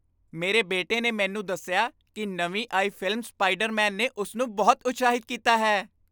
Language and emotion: Punjabi, happy